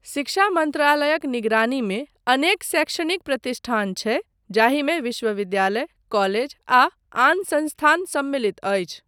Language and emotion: Maithili, neutral